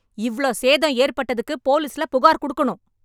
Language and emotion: Tamil, angry